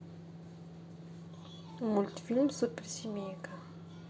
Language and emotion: Russian, neutral